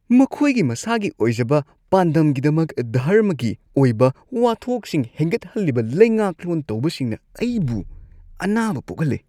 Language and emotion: Manipuri, disgusted